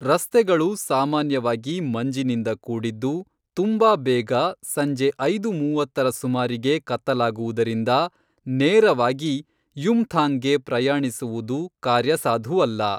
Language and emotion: Kannada, neutral